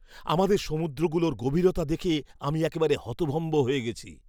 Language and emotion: Bengali, surprised